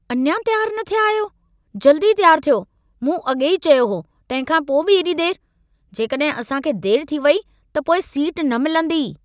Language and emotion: Sindhi, angry